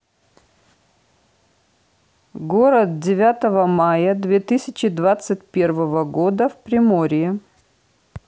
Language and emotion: Russian, neutral